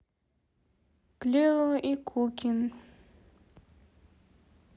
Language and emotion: Russian, neutral